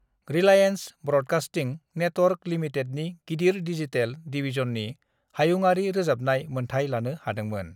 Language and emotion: Bodo, neutral